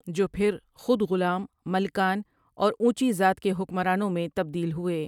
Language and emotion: Urdu, neutral